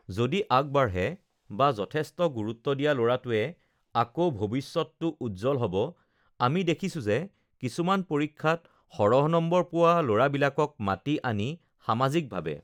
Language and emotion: Assamese, neutral